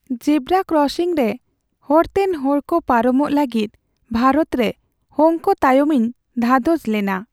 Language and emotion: Santali, sad